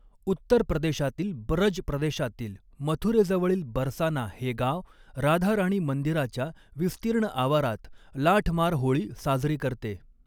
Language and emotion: Marathi, neutral